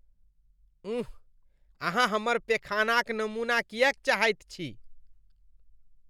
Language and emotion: Maithili, disgusted